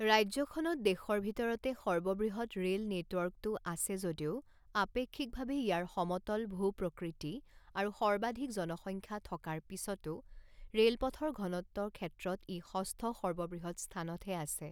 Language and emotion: Assamese, neutral